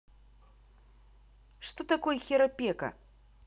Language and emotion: Russian, neutral